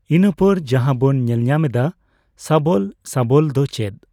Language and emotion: Santali, neutral